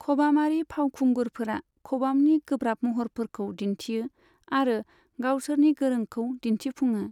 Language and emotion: Bodo, neutral